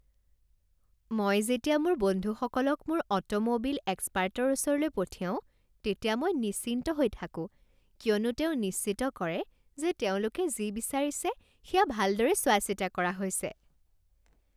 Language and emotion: Assamese, happy